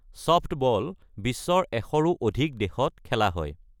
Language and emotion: Assamese, neutral